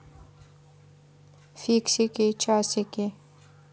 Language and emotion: Russian, neutral